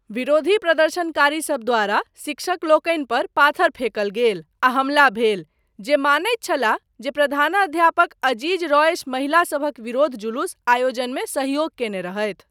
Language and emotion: Maithili, neutral